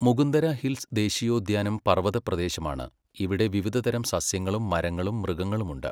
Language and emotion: Malayalam, neutral